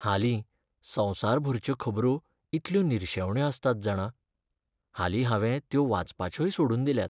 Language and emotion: Goan Konkani, sad